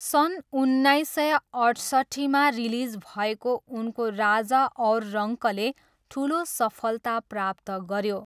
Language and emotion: Nepali, neutral